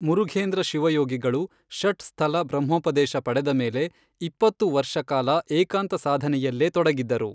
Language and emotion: Kannada, neutral